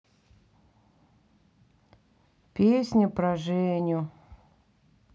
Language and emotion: Russian, sad